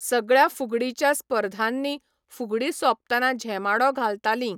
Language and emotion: Goan Konkani, neutral